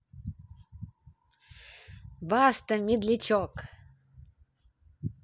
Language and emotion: Russian, positive